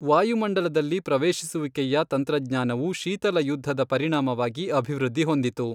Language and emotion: Kannada, neutral